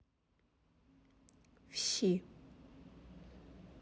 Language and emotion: Russian, neutral